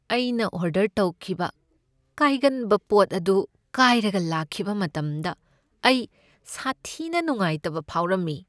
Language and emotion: Manipuri, sad